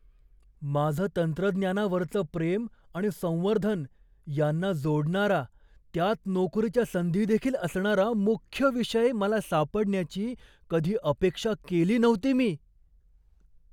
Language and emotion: Marathi, surprised